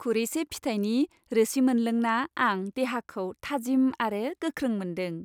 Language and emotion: Bodo, happy